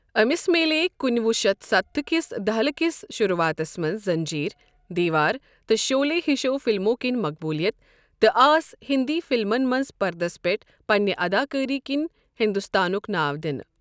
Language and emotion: Kashmiri, neutral